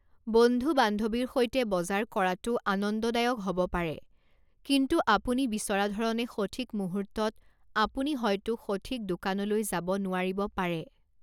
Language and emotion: Assamese, neutral